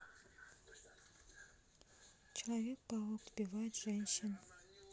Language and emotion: Russian, neutral